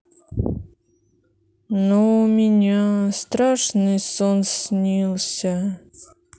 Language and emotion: Russian, sad